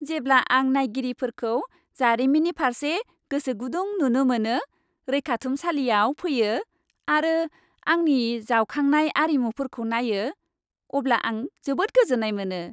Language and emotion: Bodo, happy